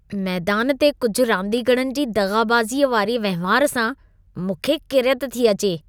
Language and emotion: Sindhi, disgusted